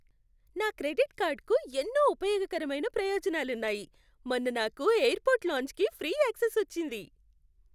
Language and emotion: Telugu, happy